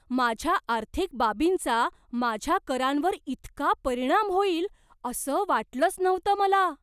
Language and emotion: Marathi, surprised